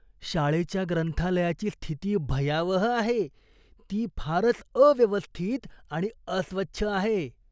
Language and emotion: Marathi, disgusted